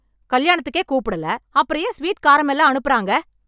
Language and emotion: Tamil, angry